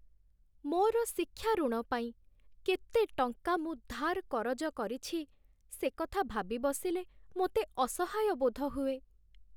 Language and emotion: Odia, sad